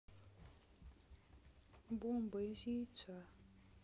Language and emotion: Russian, sad